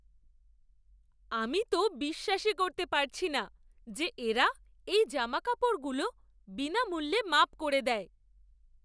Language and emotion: Bengali, surprised